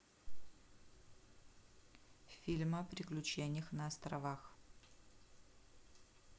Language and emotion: Russian, neutral